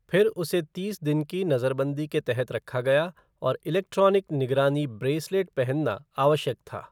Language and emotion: Hindi, neutral